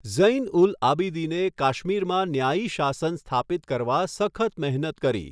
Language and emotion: Gujarati, neutral